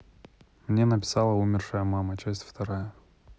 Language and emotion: Russian, neutral